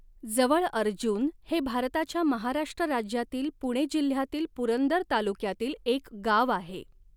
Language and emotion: Marathi, neutral